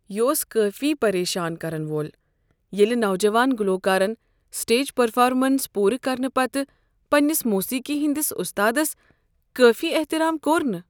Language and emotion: Kashmiri, sad